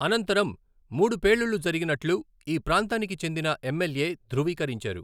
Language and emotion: Telugu, neutral